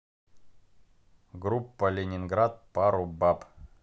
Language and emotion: Russian, neutral